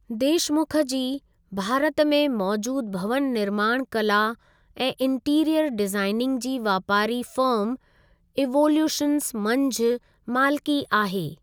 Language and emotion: Sindhi, neutral